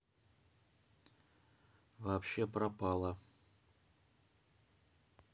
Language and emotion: Russian, neutral